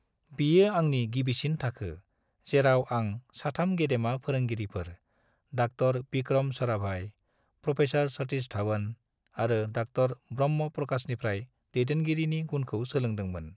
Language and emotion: Bodo, neutral